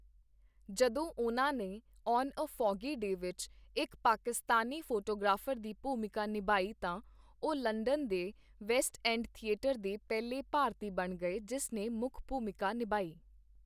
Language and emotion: Punjabi, neutral